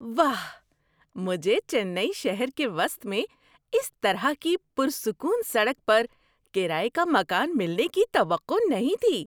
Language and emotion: Urdu, surprised